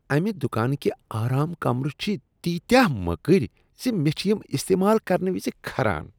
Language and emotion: Kashmiri, disgusted